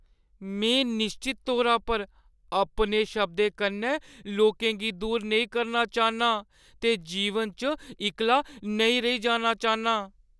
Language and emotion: Dogri, fearful